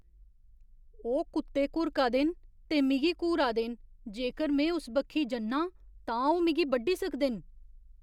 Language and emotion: Dogri, fearful